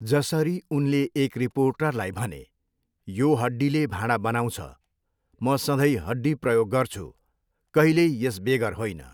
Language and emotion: Nepali, neutral